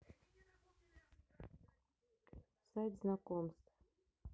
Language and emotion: Russian, neutral